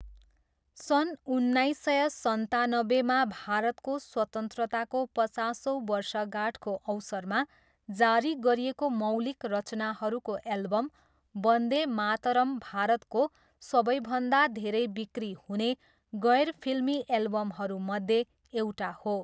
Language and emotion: Nepali, neutral